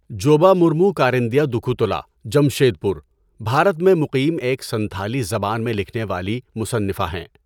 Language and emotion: Urdu, neutral